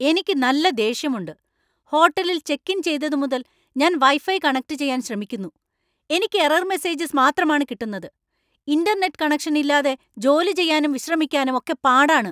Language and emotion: Malayalam, angry